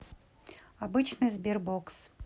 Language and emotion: Russian, neutral